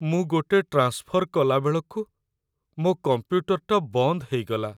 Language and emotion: Odia, sad